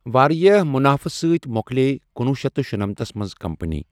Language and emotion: Kashmiri, neutral